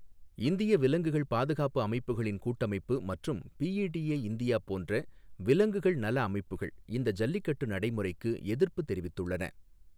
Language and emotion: Tamil, neutral